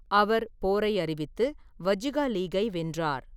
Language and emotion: Tamil, neutral